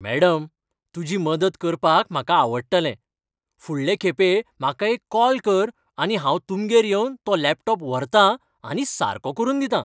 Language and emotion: Goan Konkani, happy